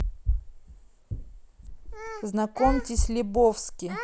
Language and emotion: Russian, neutral